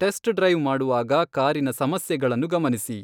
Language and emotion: Kannada, neutral